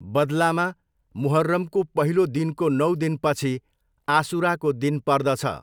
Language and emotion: Nepali, neutral